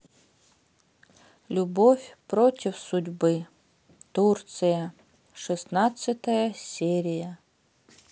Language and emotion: Russian, sad